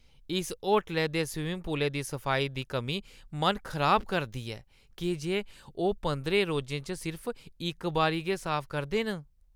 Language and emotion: Dogri, disgusted